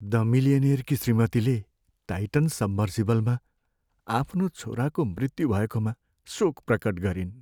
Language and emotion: Nepali, sad